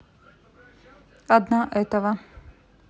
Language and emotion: Russian, neutral